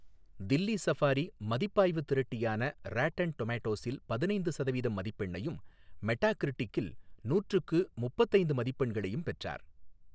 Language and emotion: Tamil, neutral